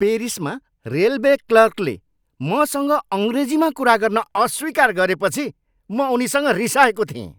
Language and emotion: Nepali, angry